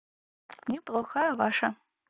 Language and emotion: Russian, neutral